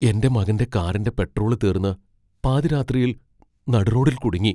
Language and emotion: Malayalam, fearful